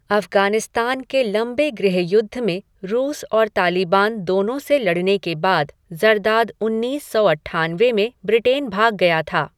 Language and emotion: Hindi, neutral